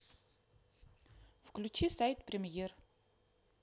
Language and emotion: Russian, neutral